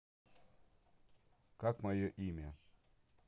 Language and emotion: Russian, neutral